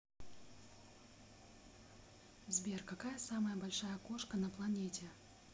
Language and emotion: Russian, neutral